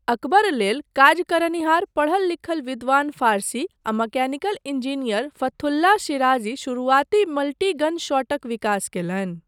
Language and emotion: Maithili, neutral